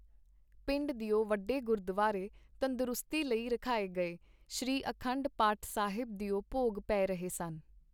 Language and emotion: Punjabi, neutral